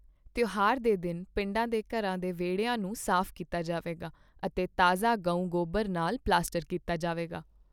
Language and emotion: Punjabi, neutral